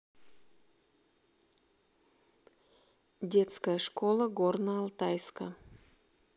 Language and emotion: Russian, neutral